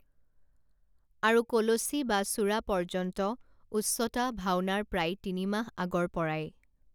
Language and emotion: Assamese, neutral